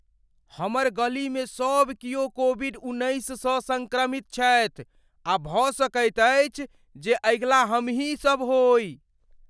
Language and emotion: Maithili, fearful